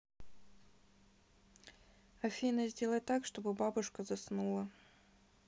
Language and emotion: Russian, neutral